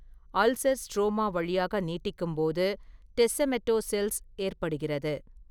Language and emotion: Tamil, neutral